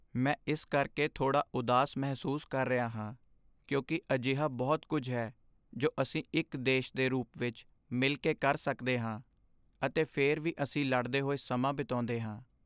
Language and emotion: Punjabi, sad